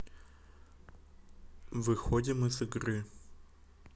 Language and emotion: Russian, neutral